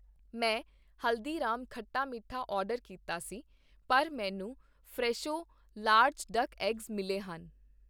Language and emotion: Punjabi, neutral